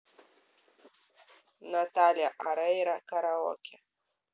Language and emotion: Russian, neutral